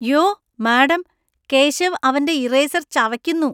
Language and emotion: Malayalam, disgusted